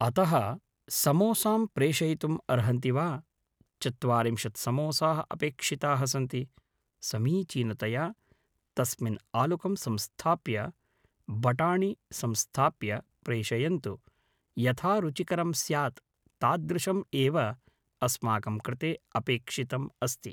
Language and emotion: Sanskrit, neutral